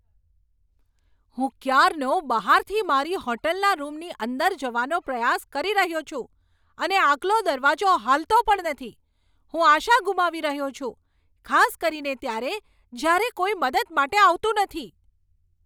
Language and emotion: Gujarati, angry